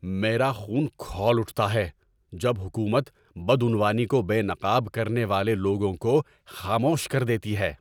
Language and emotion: Urdu, angry